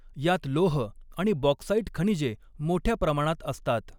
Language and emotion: Marathi, neutral